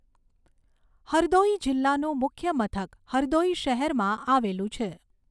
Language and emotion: Gujarati, neutral